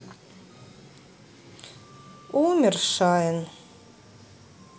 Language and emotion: Russian, sad